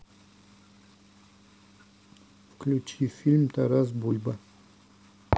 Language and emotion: Russian, neutral